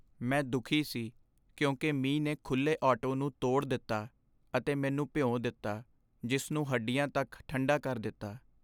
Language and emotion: Punjabi, sad